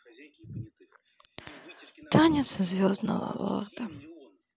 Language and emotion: Russian, sad